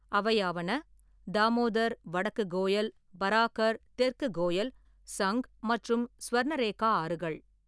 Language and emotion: Tamil, neutral